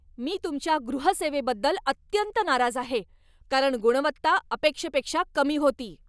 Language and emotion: Marathi, angry